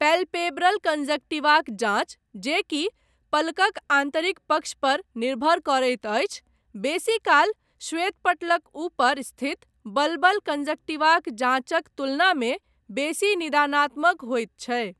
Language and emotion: Maithili, neutral